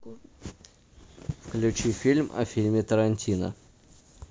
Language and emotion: Russian, neutral